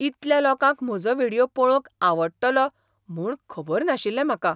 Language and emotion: Goan Konkani, surprised